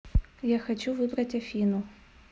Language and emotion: Russian, neutral